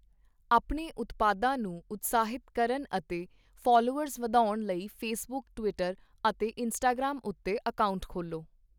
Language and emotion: Punjabi, neutral